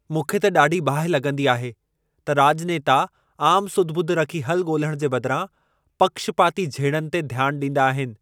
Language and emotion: Sindhi, angry